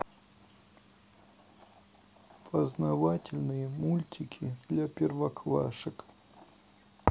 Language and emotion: Russian, neutral